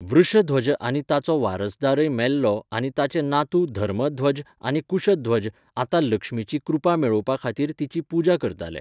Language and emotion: Goan Konkani, neutral